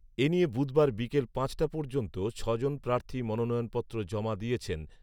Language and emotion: Bengali, neutral